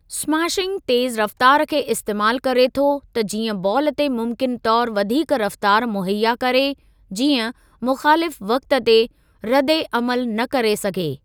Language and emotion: Sindhi, neutral